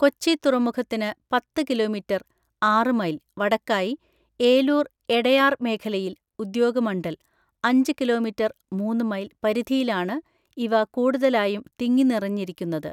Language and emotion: Malayalam, neutral